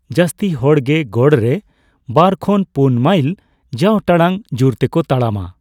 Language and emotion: Santali, neutral